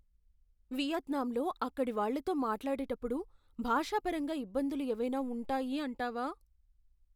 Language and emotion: Telugu, fearful